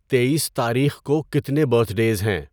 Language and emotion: Urdu, neutral